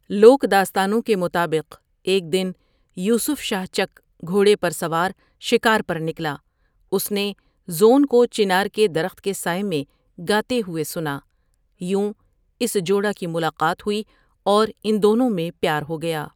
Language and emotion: Urdu, neutral